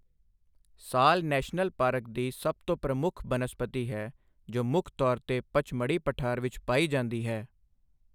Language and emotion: Punjabi, neutral